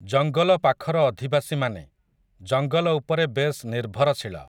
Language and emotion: Odia, neutral